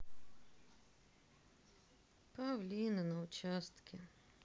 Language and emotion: Russian, sad